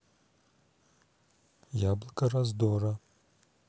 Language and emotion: Russian, neutral